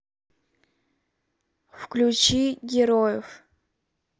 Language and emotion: Russian, neutral